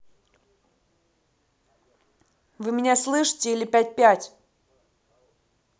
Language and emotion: Russian, angry